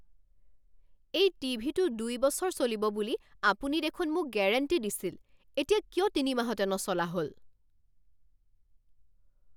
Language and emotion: Assamese, angry